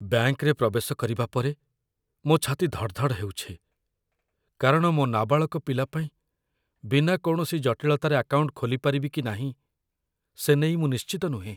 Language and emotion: Odia, fearful